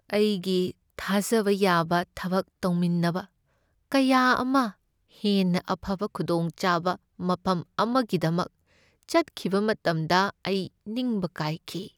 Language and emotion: Manipuri, sad